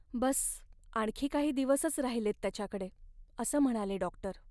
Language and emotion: Marathi, sad